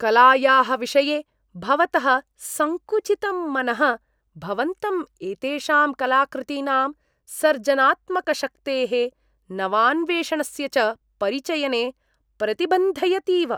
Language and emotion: Sanskrit, disgusted